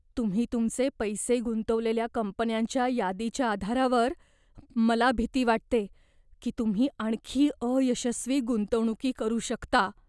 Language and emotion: Marathi, fearful